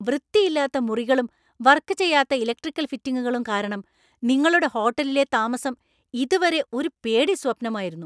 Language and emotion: Malayalam, angry